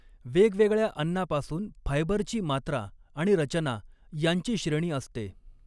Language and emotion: Marathi, neutral